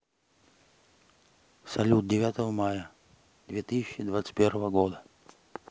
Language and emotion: Russian, neutral